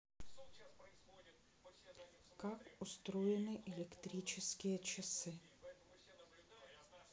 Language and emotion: Russian, neutral